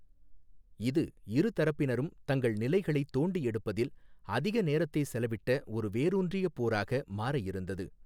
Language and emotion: Tamil, neutral